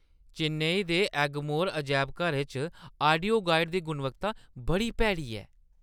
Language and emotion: Dogri, disgusted